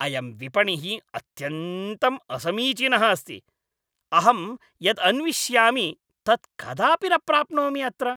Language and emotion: Sanskrit, angry